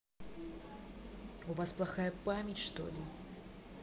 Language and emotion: Russian, angry